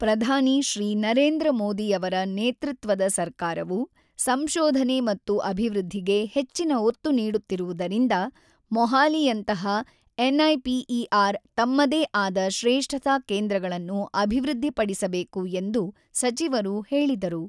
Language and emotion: Kannada, neutral